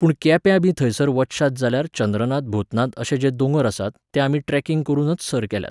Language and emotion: Goan Konkani, neutral